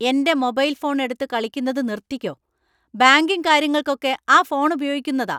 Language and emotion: Malayalam, angry